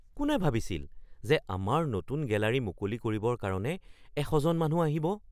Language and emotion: Assamese, surprised